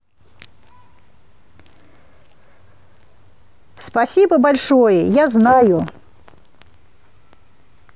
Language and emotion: Russian, positive